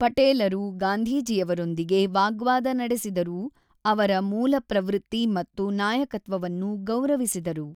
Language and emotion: Kannada, neutral